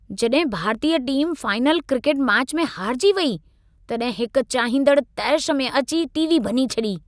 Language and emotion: Sindhi, angry